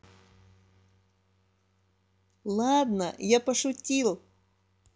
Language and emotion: Russian, positive